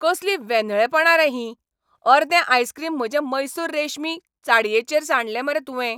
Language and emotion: Goan Konkani, angry